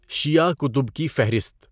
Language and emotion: Urdu, neutral